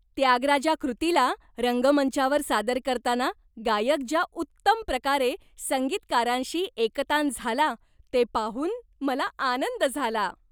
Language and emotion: Marathi, happy